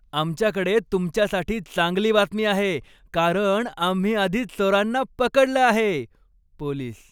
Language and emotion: Marathi, happy